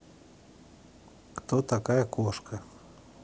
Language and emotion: Russian, neutral